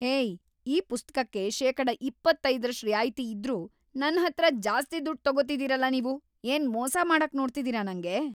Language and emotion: Kannada, angry